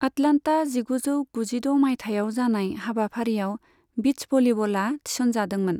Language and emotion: Bodo, neutral